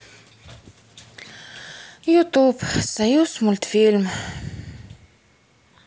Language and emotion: Russian, sad